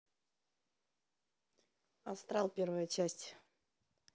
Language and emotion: Russian, neutral